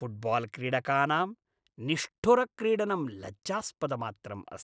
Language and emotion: Sanskrit, disgusted